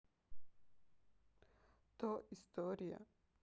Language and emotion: Russian, sad